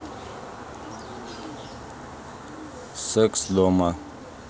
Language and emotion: Russian, neutral